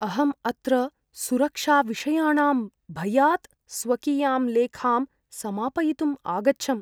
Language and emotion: Sanskrit, fearful